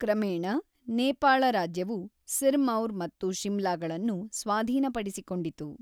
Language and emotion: Kannada, neutral